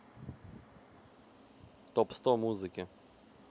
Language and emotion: Russian, neutral